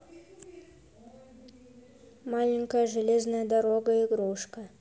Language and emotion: Russian, neutral